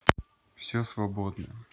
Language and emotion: Russian, neutral